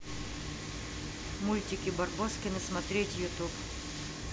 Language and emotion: Russian, neutral